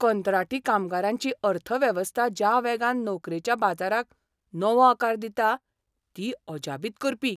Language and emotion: Goan Konkani, surprised